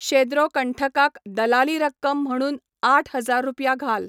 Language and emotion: Goan Konkani, neutral